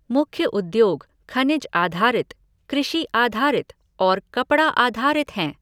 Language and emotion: Hindi, neutral